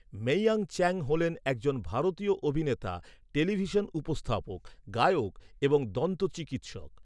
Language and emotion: Bengali, neutral